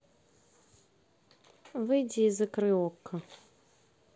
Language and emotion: Russian, neutral